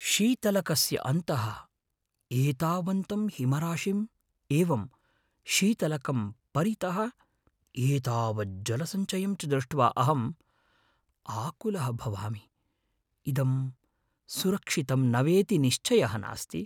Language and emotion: Sanskrit, fearful